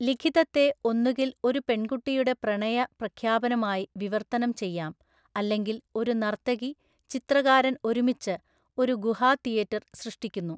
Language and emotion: Malayalam, neutral